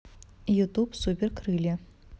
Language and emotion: Russian, neutral